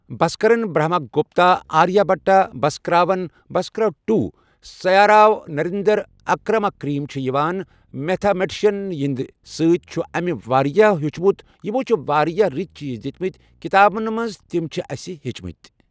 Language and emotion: Kashmiri, neutral